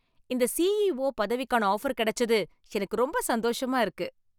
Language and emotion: Tamil, happy